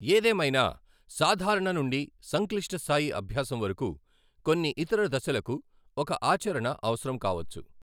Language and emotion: Telugu, neutral